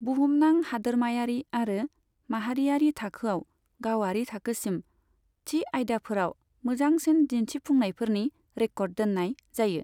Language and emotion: Bodo, neutral